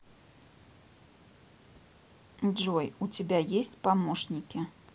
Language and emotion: Russian, neutral